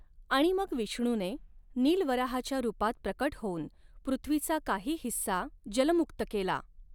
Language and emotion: Marathi, neutral